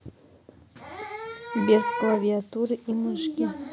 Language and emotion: Russian, neutral